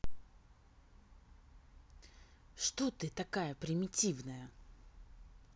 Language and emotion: Russian, angry